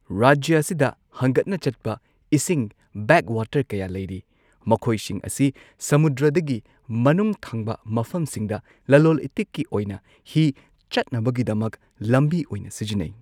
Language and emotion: Manipuri, neutral